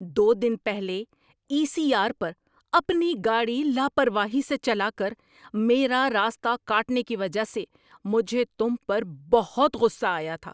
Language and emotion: Urdu, angry